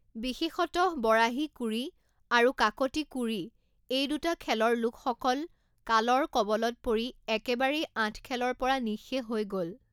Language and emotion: Assamese, neutral